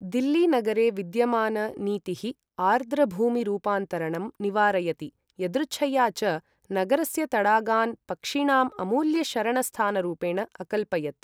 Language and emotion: Sanskrit, neutral